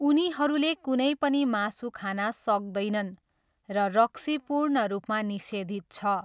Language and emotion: Nepali, neutral